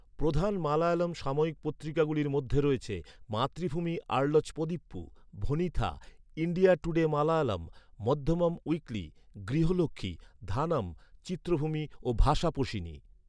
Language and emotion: Bengali, neutral